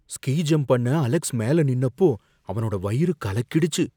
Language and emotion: Tamil, fearful